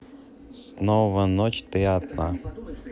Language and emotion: Russian, neutral